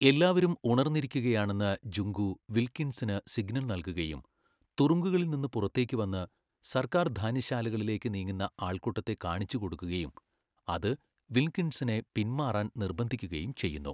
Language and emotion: Malayalam, neutral